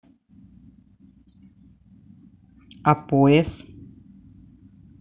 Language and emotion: Russian, neutral